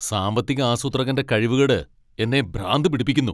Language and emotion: Malayalam, angry